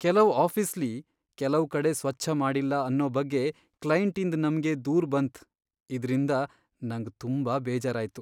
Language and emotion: Kannada, sad